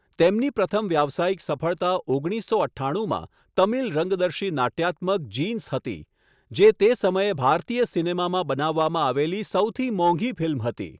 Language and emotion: Gujarati, neutral